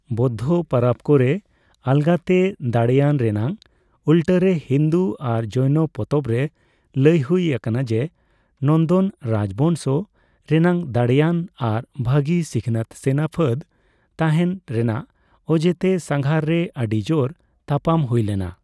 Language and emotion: Santali, neutral